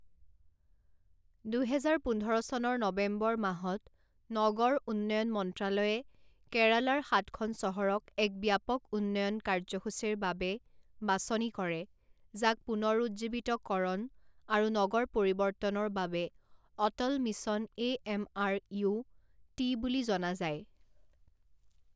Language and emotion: Assamese, neutral